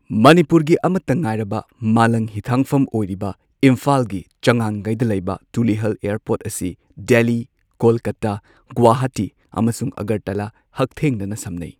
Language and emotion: Manipuri, neutral